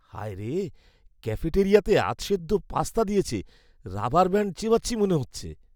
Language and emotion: Bengali, disgusted